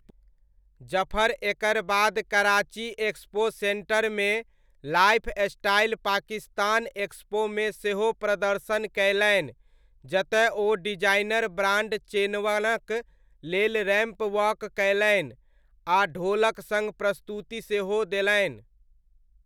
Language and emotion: Maithili, neutral